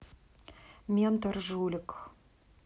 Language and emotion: Russian, neutral